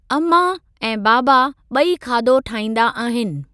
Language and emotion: Sindhi, neutral